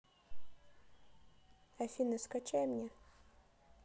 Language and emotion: Russian, neutral